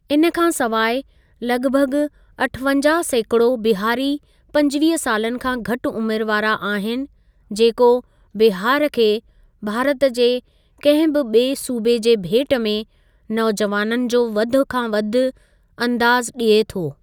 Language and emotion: Sindhi, neutral